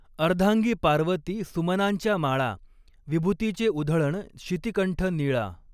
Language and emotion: Marathi, neutral